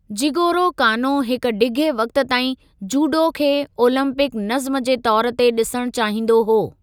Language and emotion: Sindhi, neutral